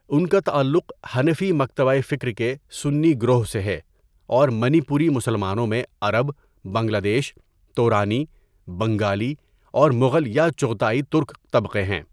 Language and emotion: Urdu, neutral